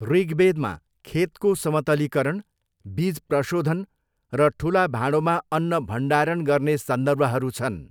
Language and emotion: Nepali, neutral